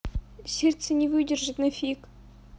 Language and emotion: Russian, sad